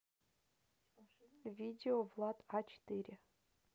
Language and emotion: Russian, neutral